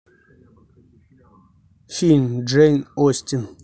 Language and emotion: Russian, neutral